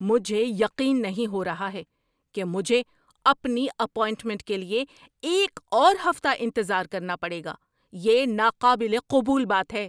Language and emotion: Urdu, angry